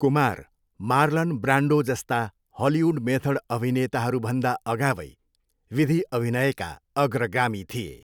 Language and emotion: Nepali, neutral